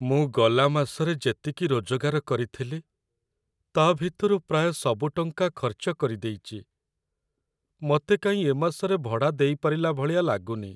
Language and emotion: Odia, sad